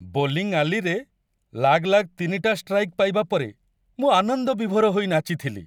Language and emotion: Odia, happy